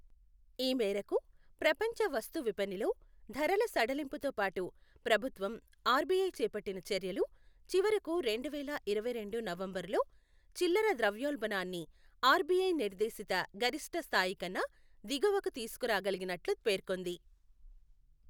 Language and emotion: Telugu, neutral